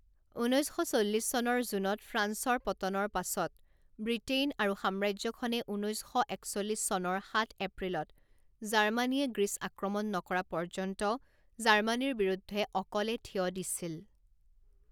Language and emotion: Assamese, neutral